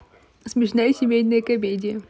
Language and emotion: Russian, positive